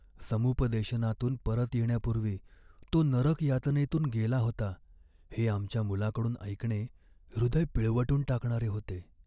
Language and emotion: Marathi, sad